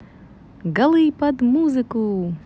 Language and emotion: Russian, positive